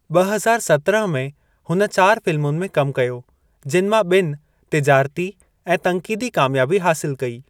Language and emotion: Sindhi, neutral